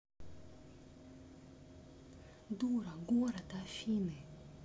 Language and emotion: Russian, neutral